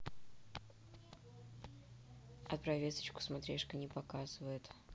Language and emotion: Russian, neutral